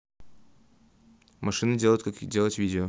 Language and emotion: Russian, neutral